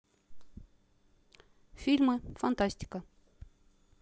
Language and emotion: Russian, neutral